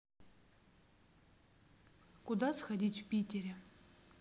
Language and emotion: Russian, neutral